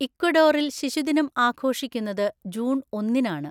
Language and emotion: Malayalam, neutral